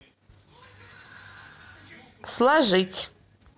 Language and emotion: Russian, neutral